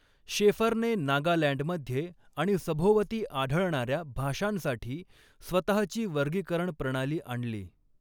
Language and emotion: Marathi, neutral